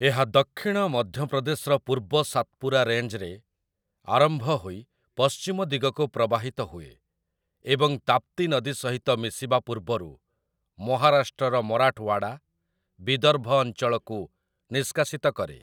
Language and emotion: Odia, neutral